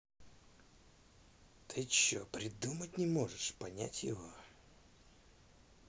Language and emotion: Russian, angry